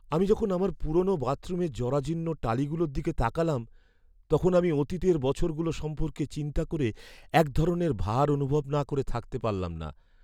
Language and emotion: Bengali, sad